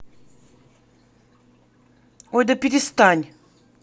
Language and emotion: Russian, angry